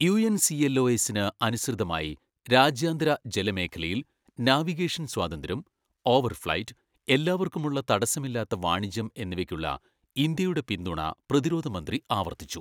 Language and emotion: Malayalam, neutral